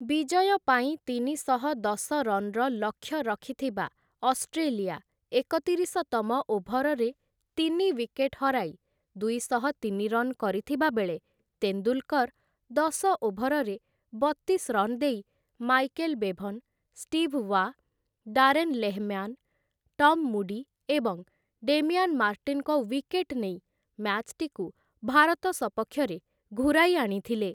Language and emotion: Odia, neutral